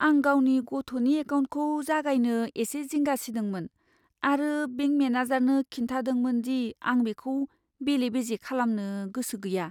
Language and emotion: Bodo, fearful